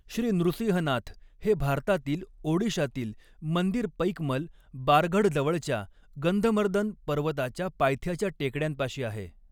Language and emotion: Marathi, neutral